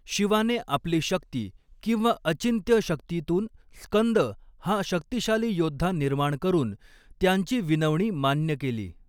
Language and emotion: Marathi, neutral